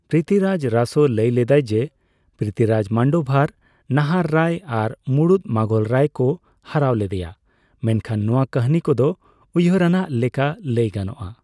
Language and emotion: Santali, neutral